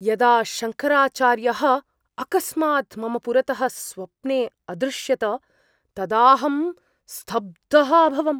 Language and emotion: Sanskrit, surprised